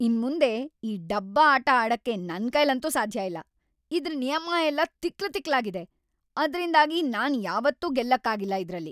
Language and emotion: Kannada, angry